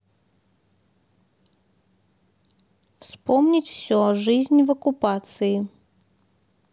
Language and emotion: Russian, neutral